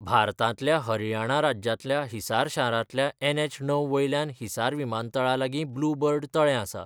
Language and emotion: Goan Konkani, neutral